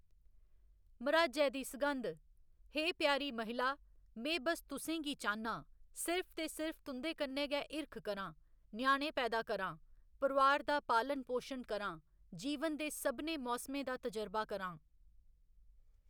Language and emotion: Dogri, neutral